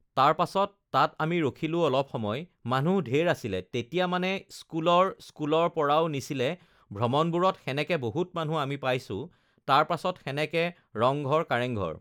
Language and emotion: Assamese, neutral